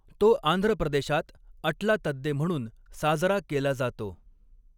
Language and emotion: Marathi, neutral